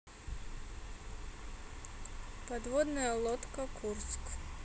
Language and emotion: Russian, neutral